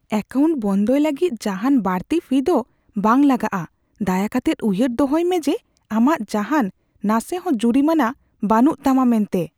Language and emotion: Santali, fearful